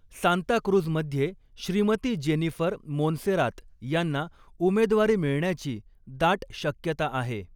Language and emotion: Marathi, neutral